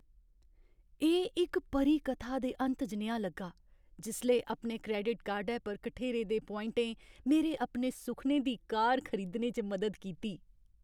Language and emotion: Dogri, happy